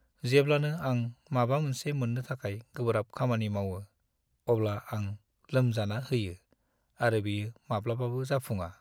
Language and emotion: Bodo, sad